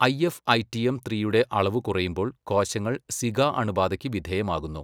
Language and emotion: Malayalam, neutral